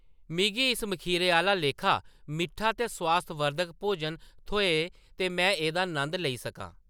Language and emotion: Dogri, neutral